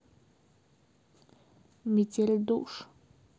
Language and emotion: Russian, sad